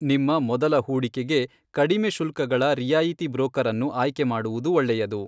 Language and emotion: Kannada, neutral